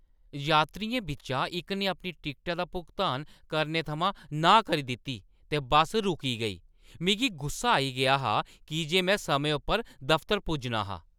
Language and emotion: Dogri, angry